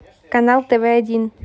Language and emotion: Russian, neutral